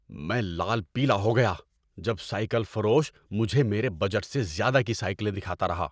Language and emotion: Urdu, angry